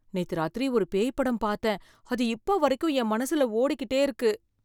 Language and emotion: Tamil, fearful